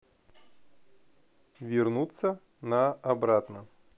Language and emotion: Russian, neutral